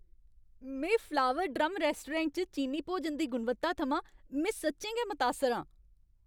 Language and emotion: Dogri, happy